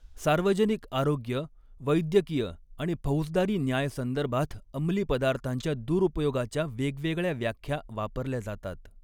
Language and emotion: Marathi, neutral